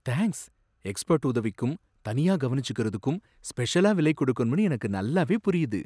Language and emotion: Tamil, surprised